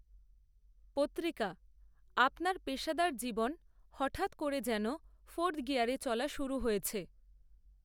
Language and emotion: Bengali, neutral